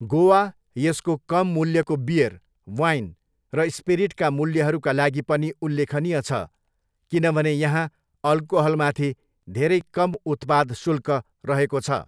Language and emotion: Nepali, neutral